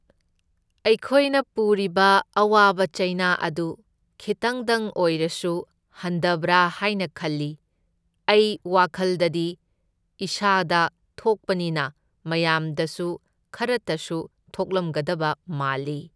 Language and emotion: Manipuri, neutral